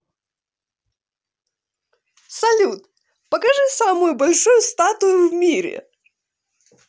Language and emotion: Russian, positive